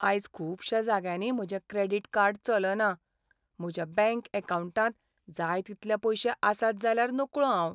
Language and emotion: Goan Konkani, sad